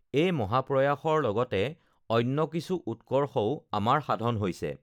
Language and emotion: Assamese, neutral